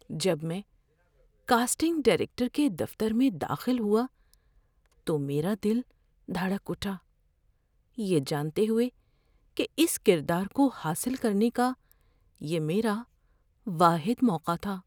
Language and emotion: Urdu, fearful